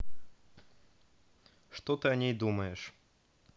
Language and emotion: Russian, neutral